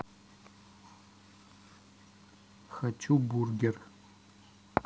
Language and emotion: Russian, neutral